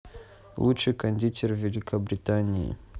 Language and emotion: Russian, neutral